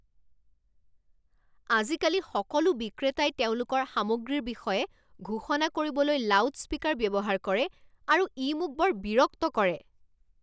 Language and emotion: Assamese, angry